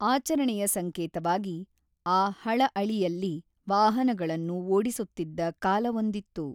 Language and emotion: Kannada, neutral